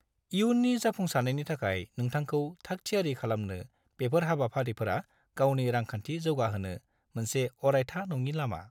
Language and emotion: Bodo, neutral